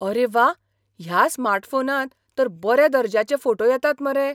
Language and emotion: Goan Konkani, surprised